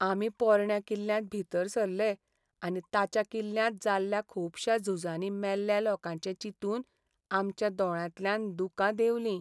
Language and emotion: Goan Konkani, sad